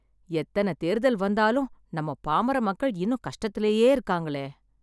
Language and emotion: Tamil, sad